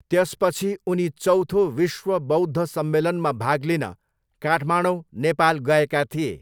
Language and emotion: Nepali, neutral